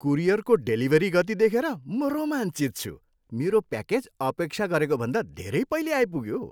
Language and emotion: Nepali, happy